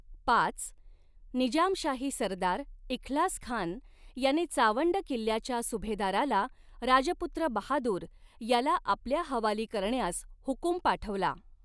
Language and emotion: Marathi, neutral